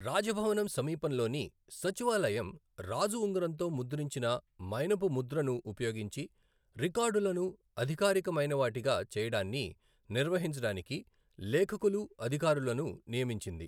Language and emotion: Telugu, neutral